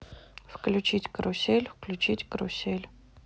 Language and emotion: Russian, neutral